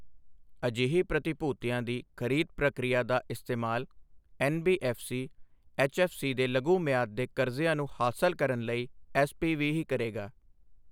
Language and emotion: Punjabi, neutral